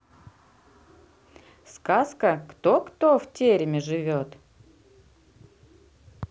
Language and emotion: Russian, neutral